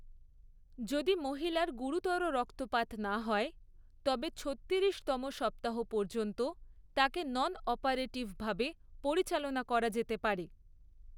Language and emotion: Bengali, neutral